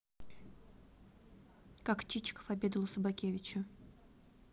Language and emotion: Russian, neutral